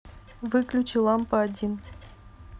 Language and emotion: Russian, neutral